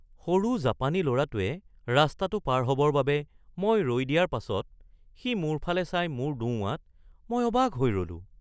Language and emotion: Assamese, surprised